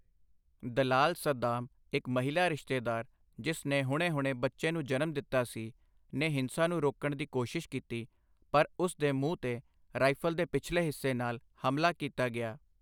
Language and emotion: Punjabi, neutral